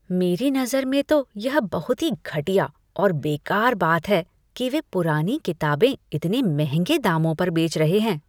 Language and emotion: Hindi, disgusted